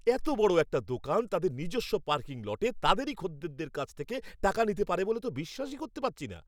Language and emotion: Bengali, angry